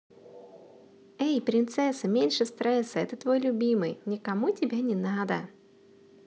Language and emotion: Russian, positive